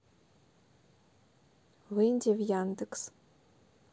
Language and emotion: Russian, neutral